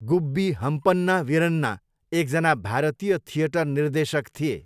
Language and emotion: Nepali, neutral